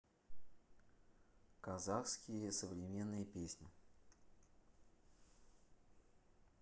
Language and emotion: Russian, neutral